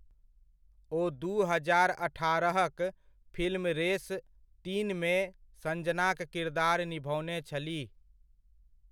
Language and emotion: Maithili, neutral